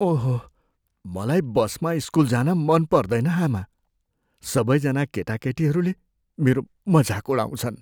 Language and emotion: Nepali, fearful